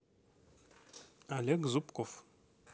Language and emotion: Russian, neutral